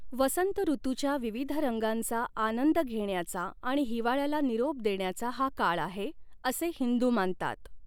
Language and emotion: Marathi, neutral